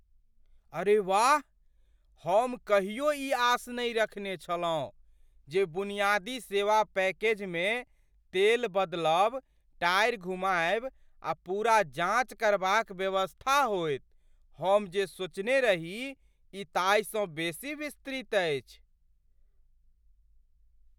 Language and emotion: Maithili, surprised